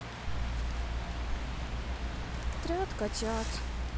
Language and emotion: Russian, sad